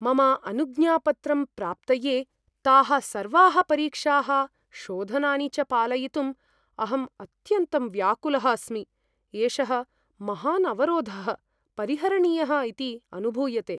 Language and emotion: Sanskrit, fearful